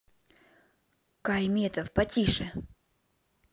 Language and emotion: Russian, neutral